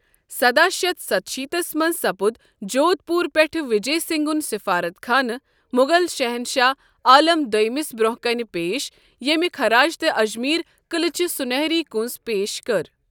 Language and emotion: Kashmiri, neutral